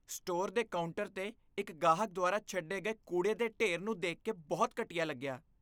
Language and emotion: Punjabi, disgusted